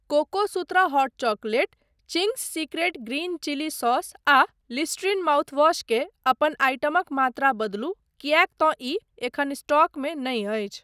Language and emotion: Maithili, neutral